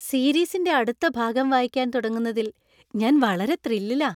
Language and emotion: Malayalam, happy